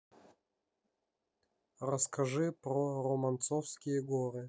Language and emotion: Russian, neutral